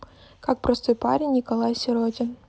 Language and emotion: Russian, neutral